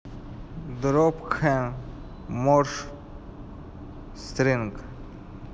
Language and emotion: Russian, neutral